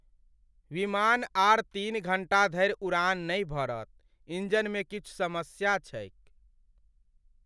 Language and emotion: Maithili, sad